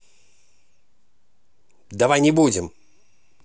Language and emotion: Russian, angry